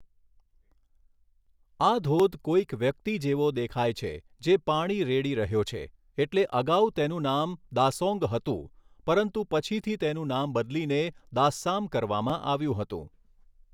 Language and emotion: Gujarati, neutral